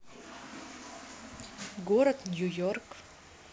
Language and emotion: Russian, neutral